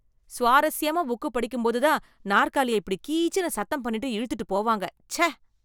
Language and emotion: Tamil, disgusted